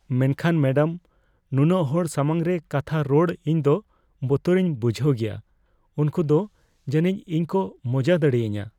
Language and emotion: Santali, fearful